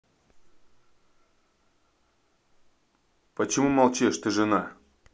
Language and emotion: Russian, neutral